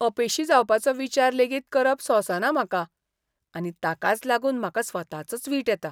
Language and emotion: Goan Konkani, disgusted